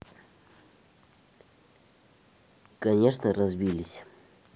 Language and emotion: Russian, neutral